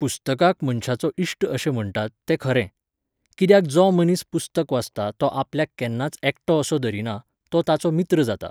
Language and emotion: Goan Konkani, neutral